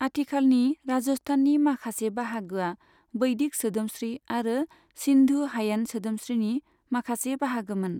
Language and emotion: Bodo, neutral